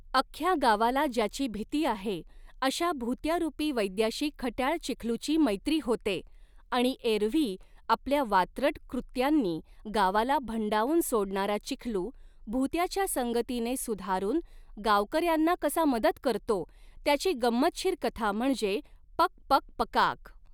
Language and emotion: Marathi, neutral